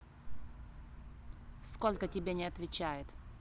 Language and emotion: Russian, angry